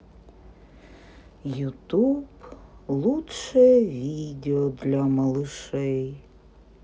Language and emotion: Russian, sad